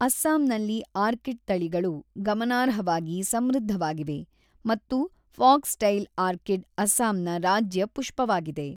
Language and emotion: Kannada, neutral